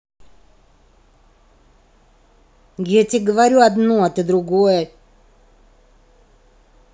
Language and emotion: Russian, angry